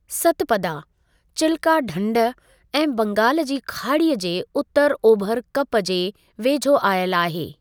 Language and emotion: Sindhi, neutral